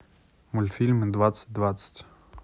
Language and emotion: Russian, neutral